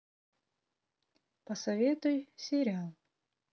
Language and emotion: Russian, neutral